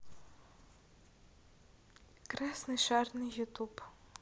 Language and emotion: Russian, neutral